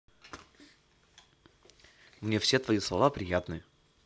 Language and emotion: Russian, positive